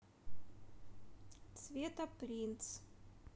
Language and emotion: Russian, neutral